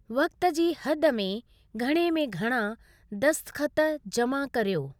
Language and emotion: Sindhi, neutral